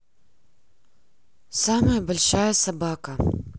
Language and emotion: Russian, neutral